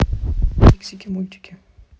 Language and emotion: Russian, neutral